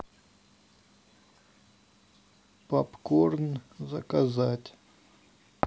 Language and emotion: Russian, sad